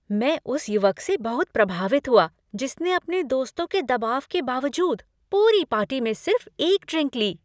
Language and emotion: Hindi, happy